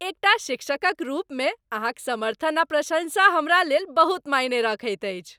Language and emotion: Maithili, happy